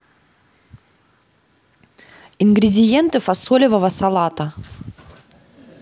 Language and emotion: Russian, neutral